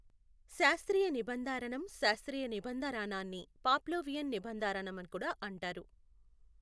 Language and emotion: Telugu, neutral